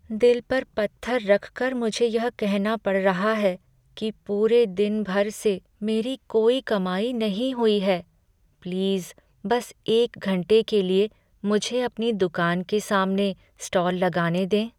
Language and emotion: Hindi, sad